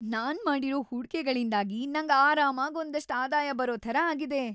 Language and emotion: Kannada, happy